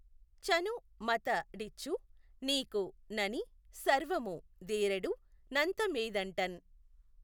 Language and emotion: Telugu, neutral